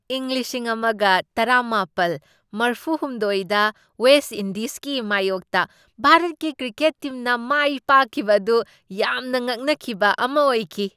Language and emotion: Manipuri, surprised